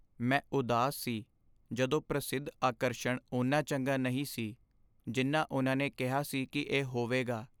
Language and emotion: Punjabi, sad